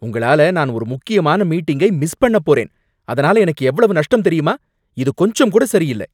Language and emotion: Tamil, angry